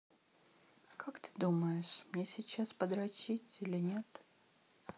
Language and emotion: Russian, sad